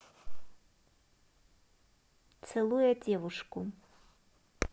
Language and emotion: Russian, neutral